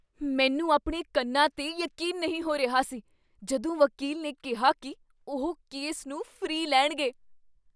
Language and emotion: Punjabi, surprised